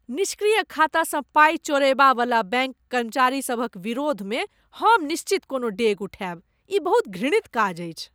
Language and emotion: Maithili, disgusted